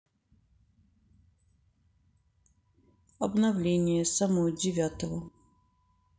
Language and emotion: Russian, neutral